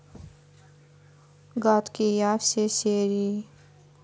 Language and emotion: Russian, neutral